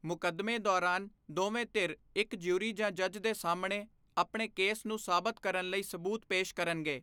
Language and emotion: Punjabi, neutral